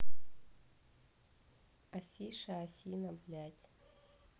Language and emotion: Russian, neutral